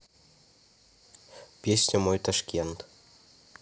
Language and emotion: Russian, neutral